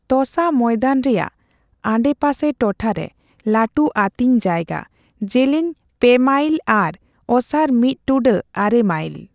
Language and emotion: Santali, neutral